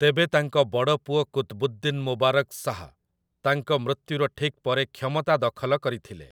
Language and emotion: Odia, neutral